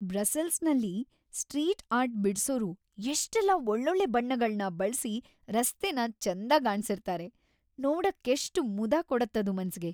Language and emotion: Kannada, happy